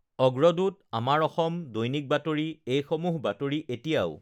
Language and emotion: Assamese, neutral